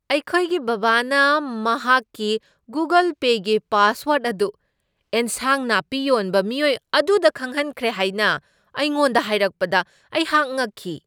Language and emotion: Manipuri, surprised